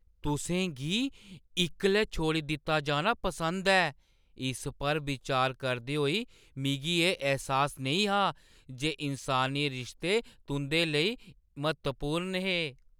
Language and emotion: Dogri, surprised